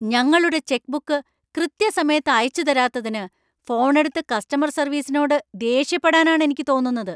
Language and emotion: Malayalam, angry